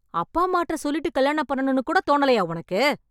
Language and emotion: Tamil, angry